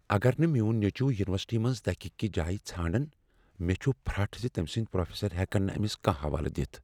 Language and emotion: Kashmiri, fearful